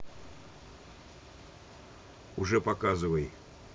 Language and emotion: Russian, neutral